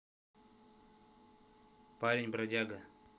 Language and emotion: Russian, neutral